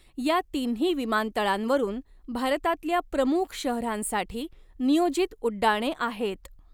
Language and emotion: Marathi, neutral